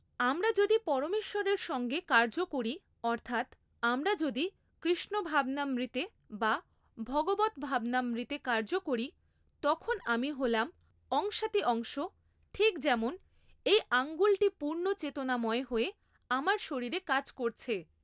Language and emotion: Bengali, neutral